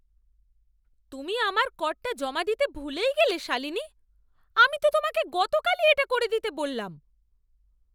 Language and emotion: Bengali, angry